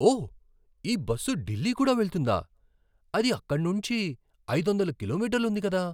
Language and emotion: Telugu, surprised